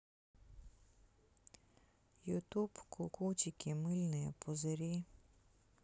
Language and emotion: Russian, sad